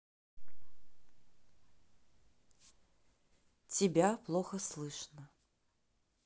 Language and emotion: Russian, neutral